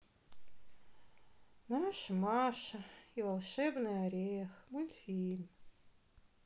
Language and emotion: Russian, sad